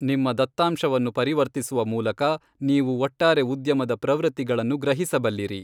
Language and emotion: Kannada, neutral